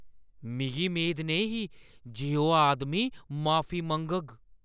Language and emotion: Dogri, surprised